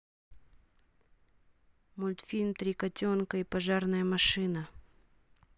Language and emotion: Russian, neutral